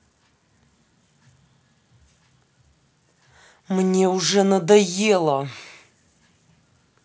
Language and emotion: Russian, angry